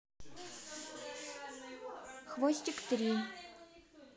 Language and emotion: Russian, neutral